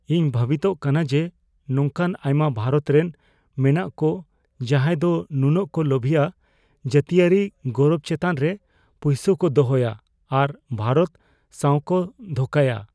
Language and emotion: Santali, fearful